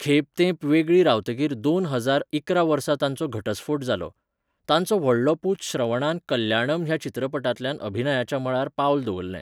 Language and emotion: Goan Konkani, neutral